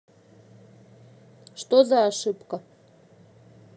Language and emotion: Russian, neutral